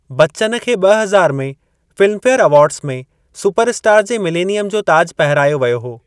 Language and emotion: Sindhi, neutral